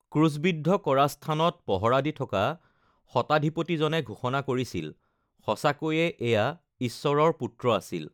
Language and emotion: Assamese, neutral